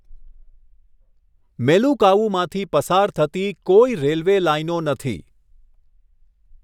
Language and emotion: Gujarati, neutral